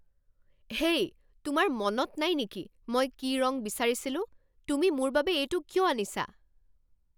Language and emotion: Assamese, angry